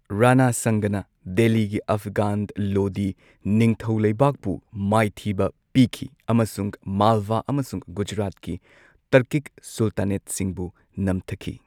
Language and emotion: Manipuri, neutral